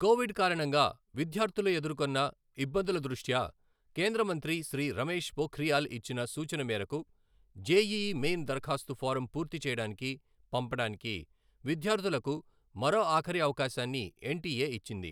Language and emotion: Telugu, neutral